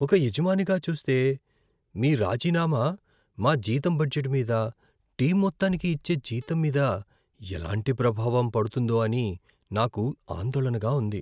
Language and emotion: Telugu, fearful